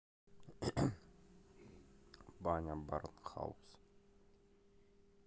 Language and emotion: Russian, neutral